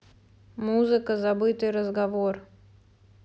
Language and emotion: Russian, neutral